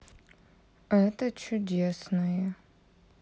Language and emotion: Russian, neutral